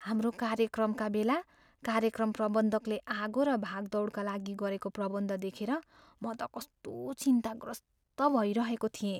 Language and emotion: Nepali, fearful